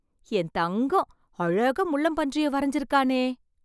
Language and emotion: Tamil, surprised